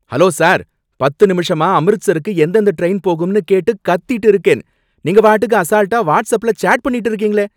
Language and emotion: Tamil, angry